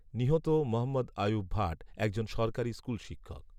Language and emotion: Bengali, neutral